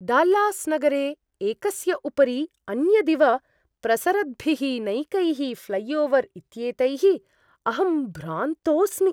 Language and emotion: Sanskrit, surprised